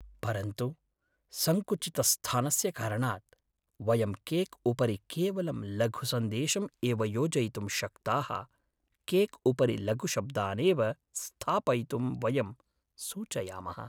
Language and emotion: Sanskrit, sad